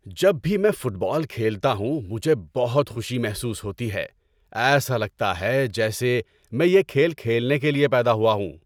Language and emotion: Urdu, happy